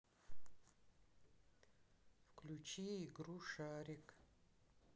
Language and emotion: Russian, neutral